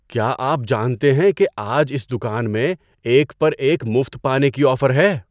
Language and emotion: Urdu, surprised